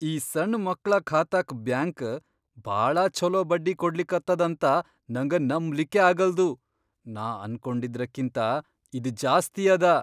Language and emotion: Kannada, surprised